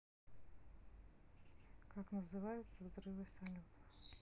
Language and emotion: Russian, neutral